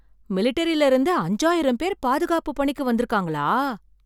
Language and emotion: Tamil, surprised